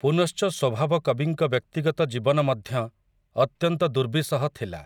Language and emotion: Odia, neutral